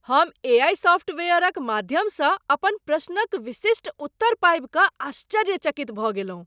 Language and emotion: Maithili, surprised